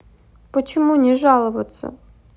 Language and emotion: Russian, sad